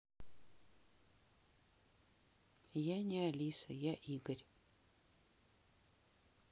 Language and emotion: Russian, neutral